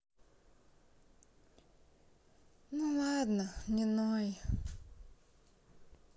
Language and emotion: Russian, sad